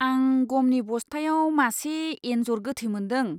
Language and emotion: Bodo, disgusted